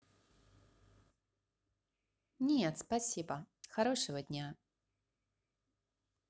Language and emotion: Russian, positive